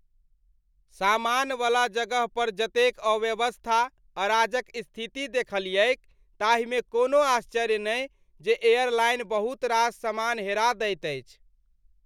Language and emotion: Maithili, disgusted